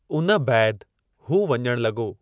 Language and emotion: Sindhi, neutral